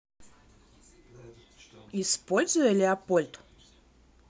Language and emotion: Russian, neutral